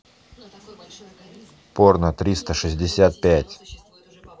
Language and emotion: Russian, neutral